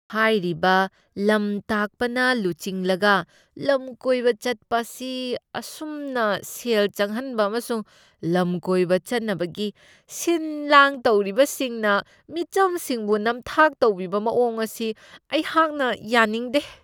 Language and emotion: Manipuri, disgusted